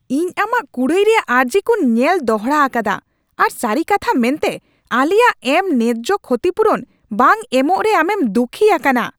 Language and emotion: Santali, angry